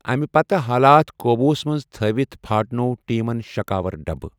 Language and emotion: Kashmiri, neutral